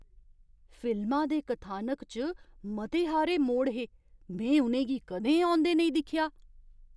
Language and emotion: Dogri, surprised